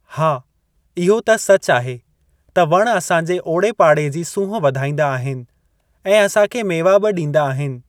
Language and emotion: Sindhi, neutral